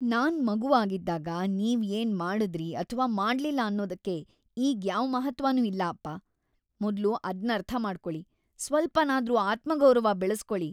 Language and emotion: Kannada, disgusted